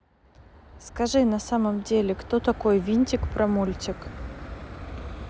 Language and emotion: Russian, neutral